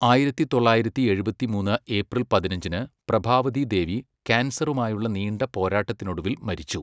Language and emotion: Malayalam, neutral